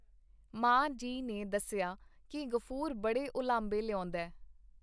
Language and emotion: Punjabi, neutral